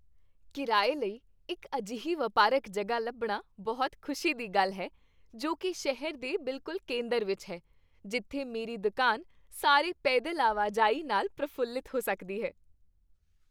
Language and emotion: Punjabi, happy